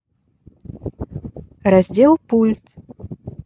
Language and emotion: Russian, neutral